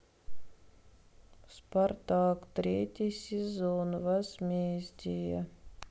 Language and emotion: Russian, sad